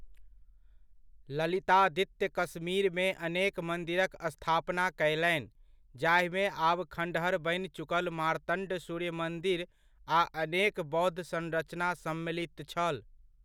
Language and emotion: Maithili, neutral